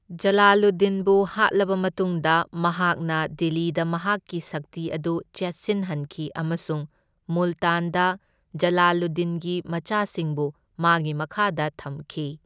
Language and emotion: Manipuri, neutral